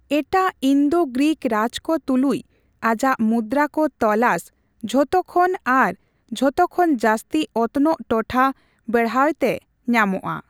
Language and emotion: Santali, neutral